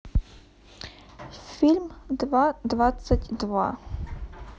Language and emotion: Russian, neutral